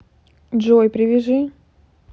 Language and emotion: Russian, neutral